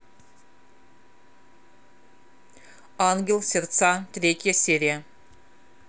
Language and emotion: Russian, neutral